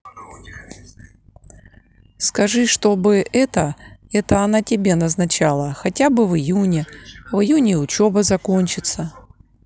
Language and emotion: Russian, neutral